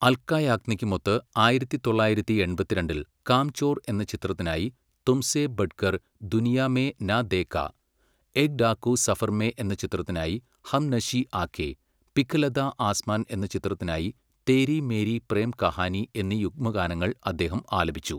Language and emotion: Malayalam, neutral